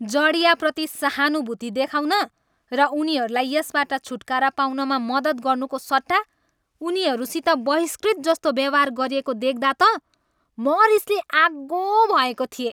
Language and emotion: Nepali, angry